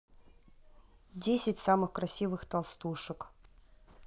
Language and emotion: Russian, neutral